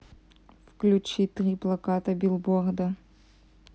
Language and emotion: Russian, neutral